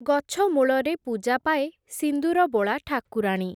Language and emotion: Odia, neutral